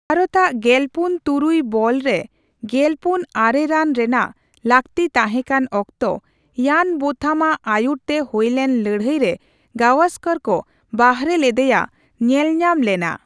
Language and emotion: Santali, neutral